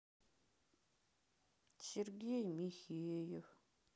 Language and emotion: Russian, sad